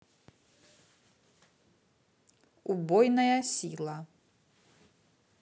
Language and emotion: Russian, neutral